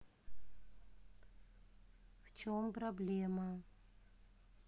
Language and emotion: Russian, neutral